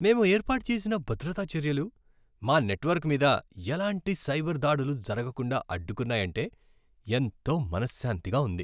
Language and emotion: Telugu, happy